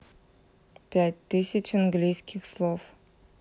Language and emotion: Russian, neutral